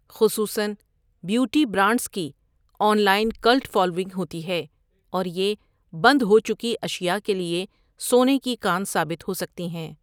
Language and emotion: Urdu, neutral